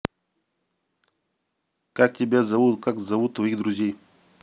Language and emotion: Russian, neutral